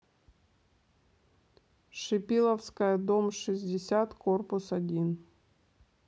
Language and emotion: Russian, neutral